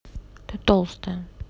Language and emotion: Russian, neutral